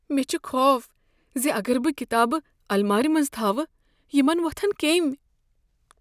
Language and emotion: Kashmiri, fearful